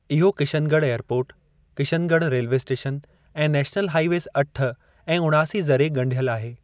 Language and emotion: Sindhi, neutral